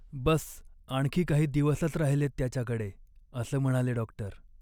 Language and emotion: Marathi, sad